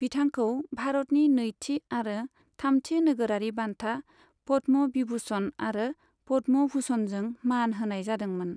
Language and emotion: Bodo, neutral